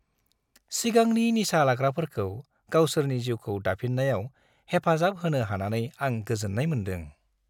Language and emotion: Bodo, happy